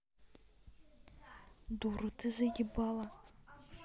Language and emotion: Russian, angry